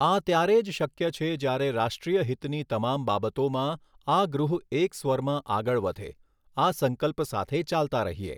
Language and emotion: Gujarati, neutral